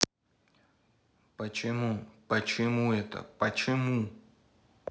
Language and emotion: Russian, angry